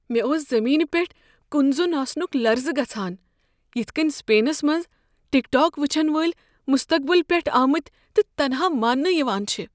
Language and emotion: Kashmiri, fearful